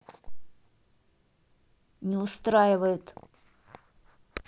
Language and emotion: Russian, angry